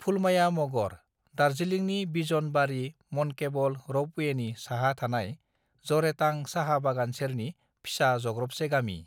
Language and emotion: Bodo, neutral